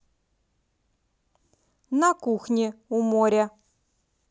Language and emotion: Russian, positive